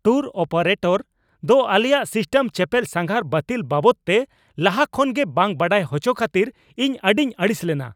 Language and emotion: Santali, angry